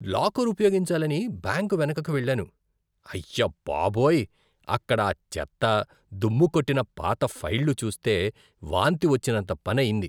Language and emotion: Telugu, disgusted